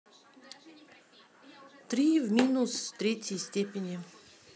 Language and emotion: Russian, neutral